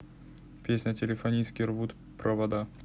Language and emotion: Russian, neutral